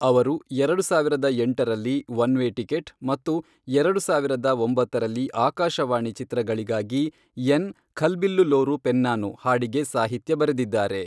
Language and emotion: Kannada, neutral